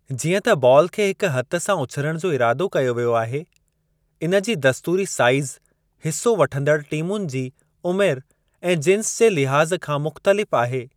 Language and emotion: Sindhi, neutral